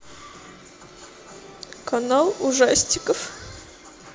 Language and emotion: Russian, sad